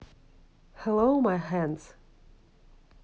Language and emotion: Russian, neutral